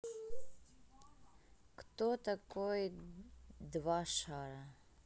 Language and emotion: Russian, neutral